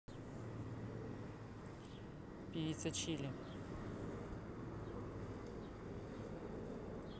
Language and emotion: Russian, neutral